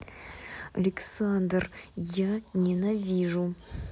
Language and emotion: Russian, angry